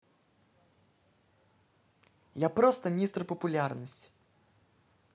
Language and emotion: Russian, positive